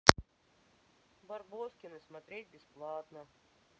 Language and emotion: Russian, sad